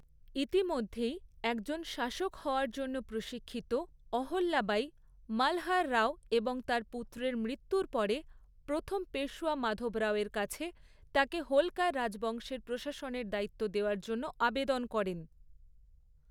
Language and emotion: Bengali, neutral